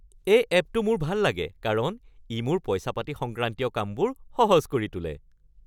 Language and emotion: Assamese, happy